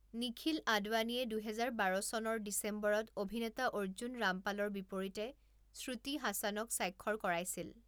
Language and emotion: Assamese, neutral